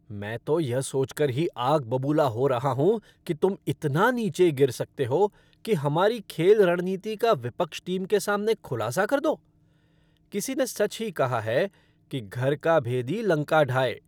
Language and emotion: Hindi, angry